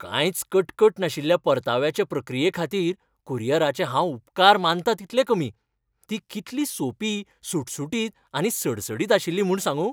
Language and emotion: Goan Konkani, happy